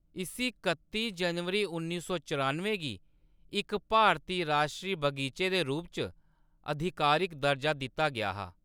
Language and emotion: Dogri, neutral